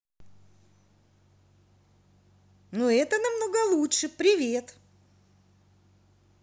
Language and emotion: Russian, positive